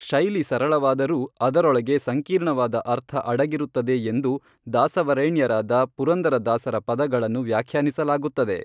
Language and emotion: Kannada, neutral